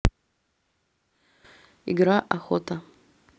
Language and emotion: Russian, neutral